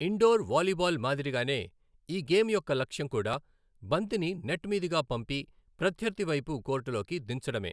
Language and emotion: Telugu, neutral